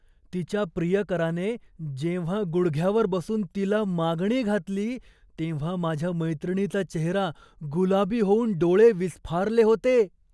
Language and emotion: Marathi, surprised